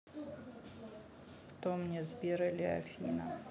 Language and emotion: Russian, neutral